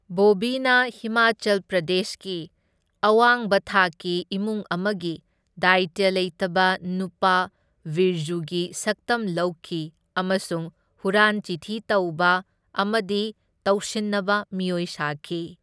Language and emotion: Manipuri, neutral